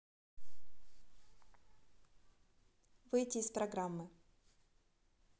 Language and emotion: Russian, neutral